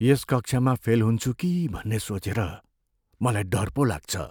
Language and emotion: Nepali, fearful